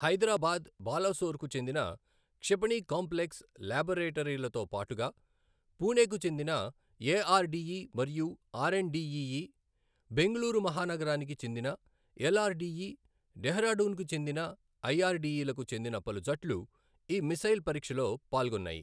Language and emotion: Telugu, neutral